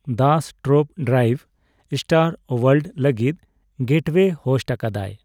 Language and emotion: Santali, neutral